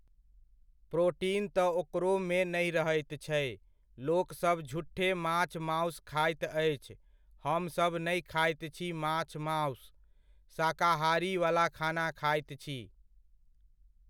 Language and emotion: Maithili, neutral